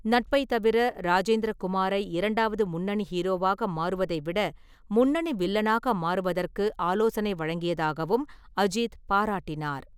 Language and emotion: Tamil, neutral